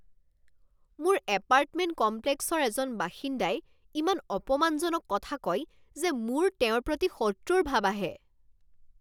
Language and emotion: Assamese, angry